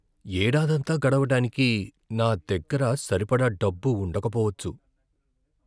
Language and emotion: Telugu, fearful